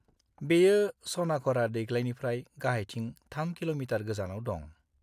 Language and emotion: Bodo, neutral